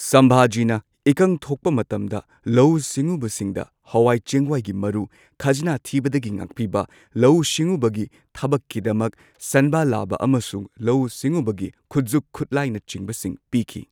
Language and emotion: Manipuri, neutral